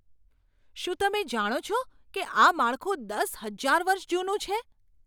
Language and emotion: Gujarati, surprised